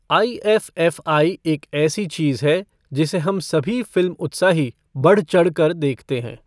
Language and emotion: Hindi, neutral